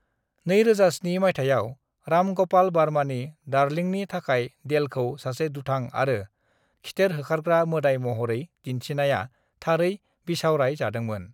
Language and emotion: Bodo, neutral